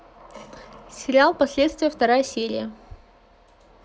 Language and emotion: Russian, neutral